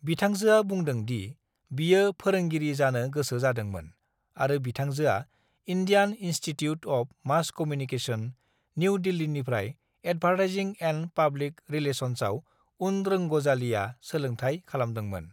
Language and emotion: Bodo, neutral